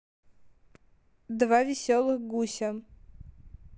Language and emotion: Russian, neutral